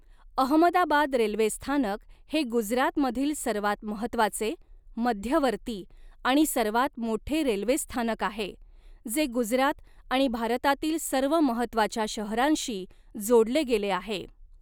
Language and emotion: Marathi, neutral